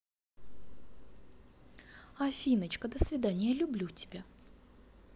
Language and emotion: Russian, positive